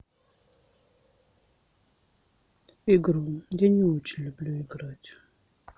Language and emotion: Russian, sad